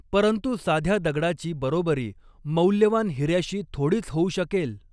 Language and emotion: Marathi, neutral